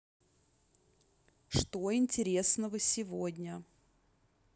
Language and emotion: Russian, neutral